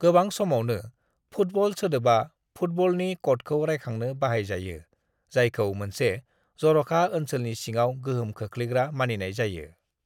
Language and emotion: Bodo, neutral